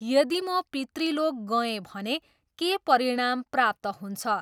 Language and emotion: Nepali, neutral